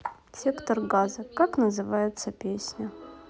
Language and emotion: Russian, neutral